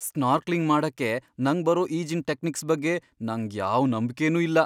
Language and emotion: Kannada, fearful